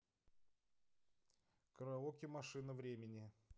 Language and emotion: Russian, neutral